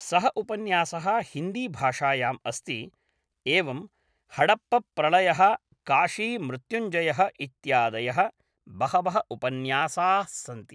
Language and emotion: Sanskrit, neutral